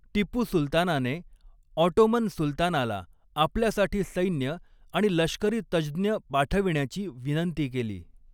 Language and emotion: Marathi, neutral